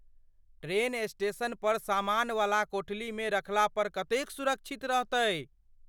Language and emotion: Maithili, fearful